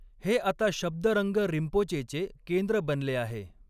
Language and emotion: Marathi, neutral